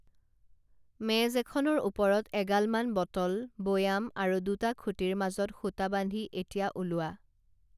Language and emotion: Assamese, neutral